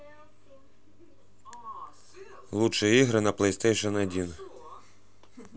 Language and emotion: Russian, neutral